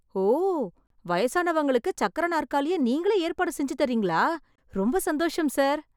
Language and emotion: Tamil, surprised